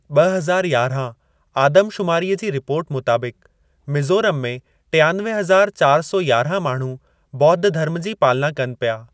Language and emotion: Sindhi, neutral